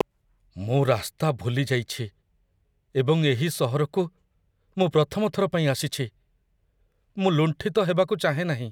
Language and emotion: Odia, fearful